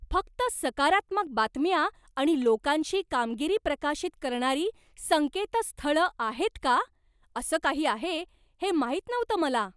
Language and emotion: Marathi, surprised